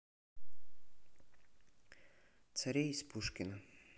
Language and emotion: Russian, neutral